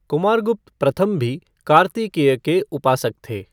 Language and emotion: Hindi, neutral